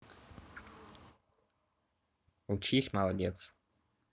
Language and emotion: Russian, neutral